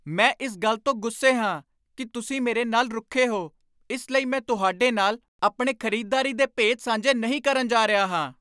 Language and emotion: Punjabi, angry